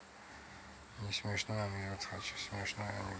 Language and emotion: Russian, neutral